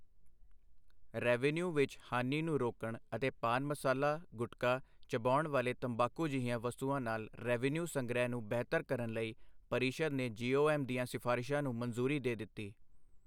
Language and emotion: Punjabi, neutral